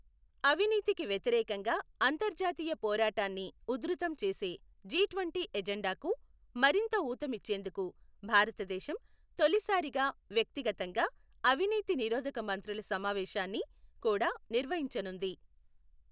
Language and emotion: Telugu, neutral